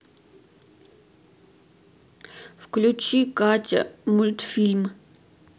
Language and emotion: Russian, sad